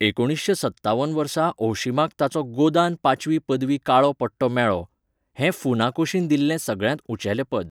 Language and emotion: Goan Konkani, neutral